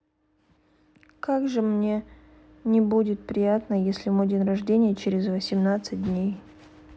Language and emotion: Russian, sad